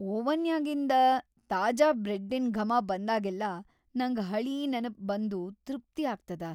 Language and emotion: Kannada, happy